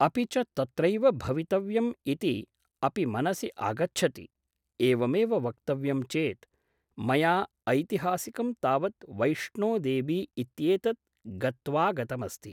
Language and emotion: Sanskrit, neutral